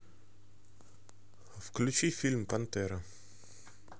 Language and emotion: Russian, neutral